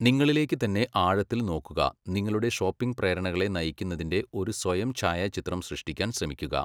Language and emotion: Malayalam, neutral